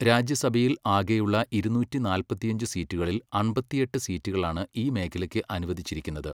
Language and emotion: Malayalam, neutral